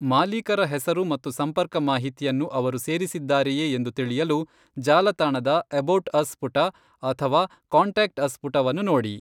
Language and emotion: Kannada, neutral